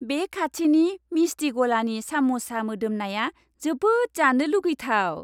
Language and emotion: Bodo, happy